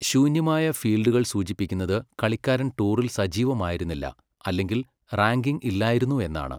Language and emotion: Malayalam, neutral